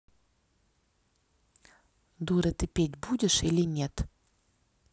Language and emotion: Russian, neutral